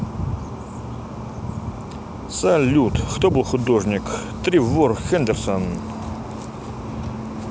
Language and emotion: Russian, positive